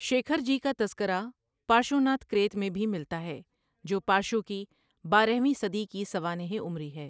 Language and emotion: Urdu, neutral